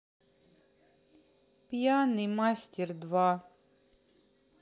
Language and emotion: Russian, sad